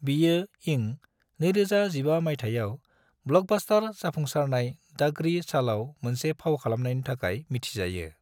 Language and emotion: Bodo, neutral